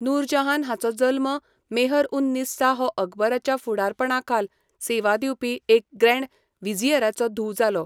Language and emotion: Goan Konkani, neutral